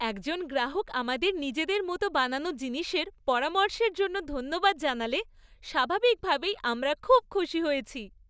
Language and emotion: Bengali, happy